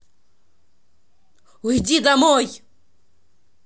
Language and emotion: Russian, angry